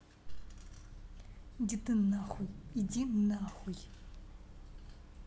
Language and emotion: Russian, angry